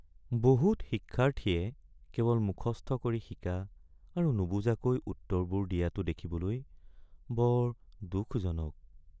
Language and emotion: Assamese, sad